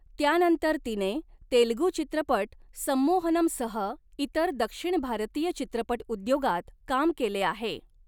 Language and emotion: Marathi, neutral